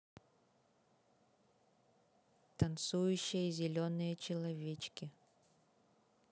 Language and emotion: Russian, neutral